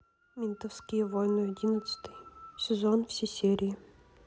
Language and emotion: Russian, neutral